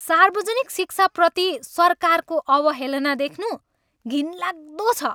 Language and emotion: Nepali, angry